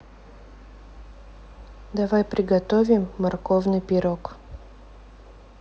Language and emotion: Russian, neutral